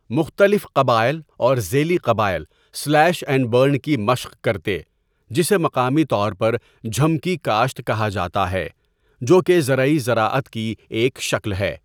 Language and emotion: Urdu, neutral